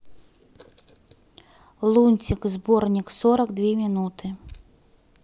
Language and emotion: Russian, neutral